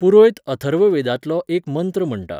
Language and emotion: Goan Konkani, neutral